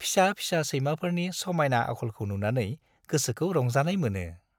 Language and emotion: Bodo, happy